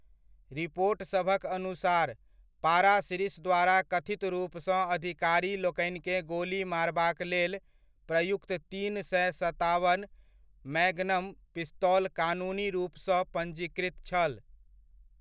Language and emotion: Maithili, neutral